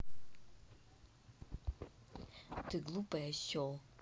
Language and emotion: Russian, angry